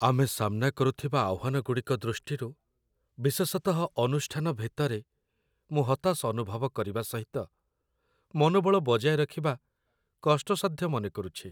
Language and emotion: Odia, sad